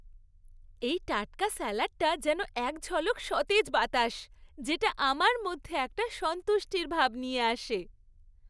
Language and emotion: Bengali, happy